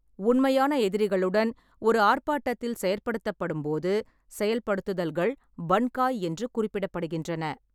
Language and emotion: Tamil, neutral